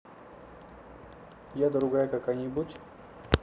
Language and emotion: Russian, neutral